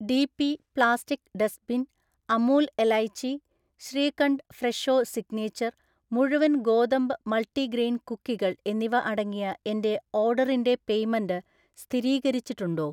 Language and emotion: Malayalam, neutral